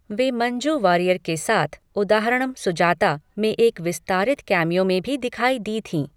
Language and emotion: Hindi, neutral